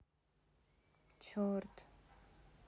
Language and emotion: Russian, sad